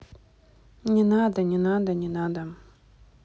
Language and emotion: Russian, neutral